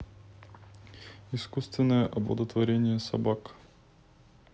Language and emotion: Russian, neutral